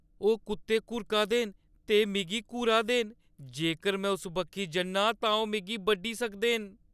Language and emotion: Dogri, fearful